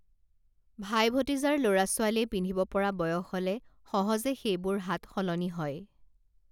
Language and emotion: Assamese, neutral